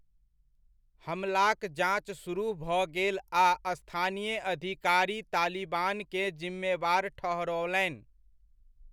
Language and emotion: Maithili, neutral